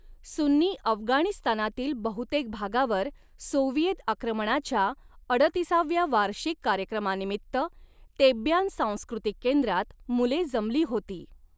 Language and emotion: Marathi, neutral